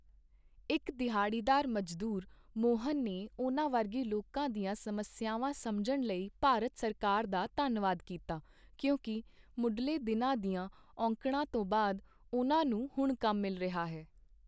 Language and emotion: Punjabi, neutral